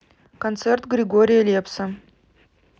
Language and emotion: Russian, neutral